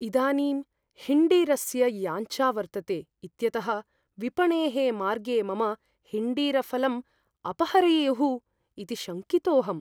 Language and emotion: Sanskrit, fearful